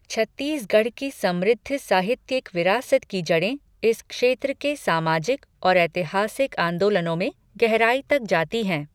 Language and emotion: Hindi, neutral